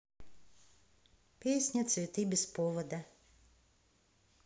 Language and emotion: Russian, neutral